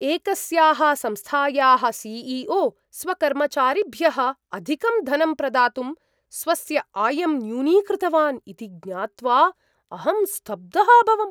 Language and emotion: Sanskrit, surprised